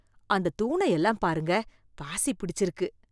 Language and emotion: Tamil, disgusted